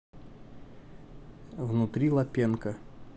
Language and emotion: Russian, neutral